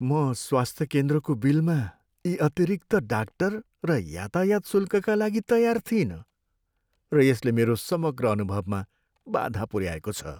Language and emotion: Nepali, sad